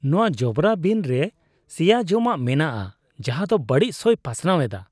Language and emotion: Santali, disgusted